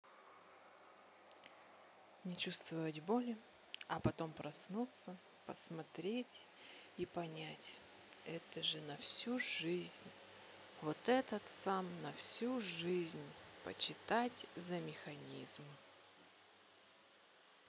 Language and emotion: Russian, neutral